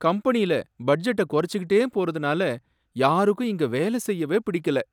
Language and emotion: Tamil, sad